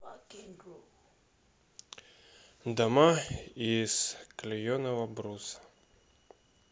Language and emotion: Russian, sad